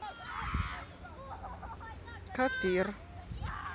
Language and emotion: Russian, neutral